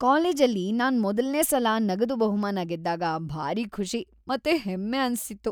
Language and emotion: Kannada, happy